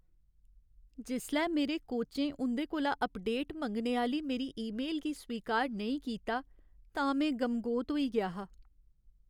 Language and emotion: Dogri, sad